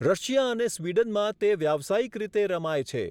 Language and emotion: Gujarati, neutral